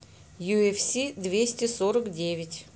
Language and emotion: Russian, neutral